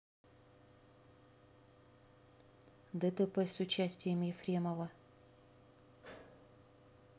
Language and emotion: Russian, neutral